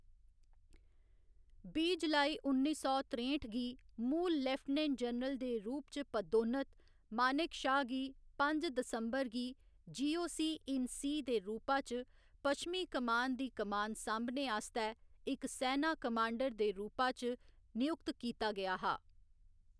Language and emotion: Dogri, neutral